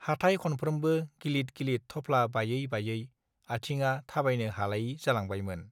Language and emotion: Bodo, neutral